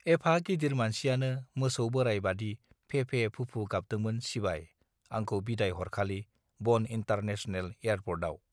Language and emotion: Bodo, neutral